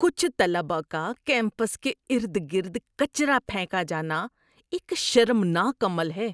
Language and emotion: Urdu, disgusted